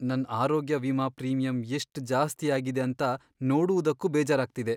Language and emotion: Kannada, sad